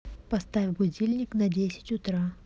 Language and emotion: Russian, neutral